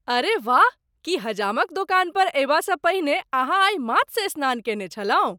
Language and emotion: Maithili, surprised